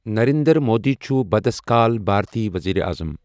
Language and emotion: Kashmiri, neutral